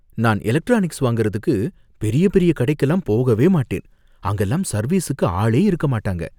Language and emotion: Tamil, fearful